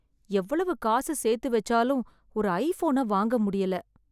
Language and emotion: Tamil, sad